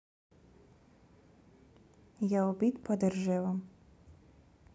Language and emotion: Russian, neutral